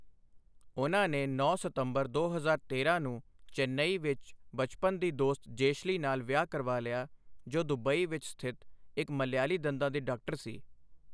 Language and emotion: Punjabi, neutral